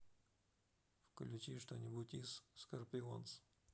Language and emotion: Russian, neutral